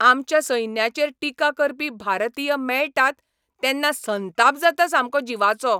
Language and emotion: Goan Konkani, angry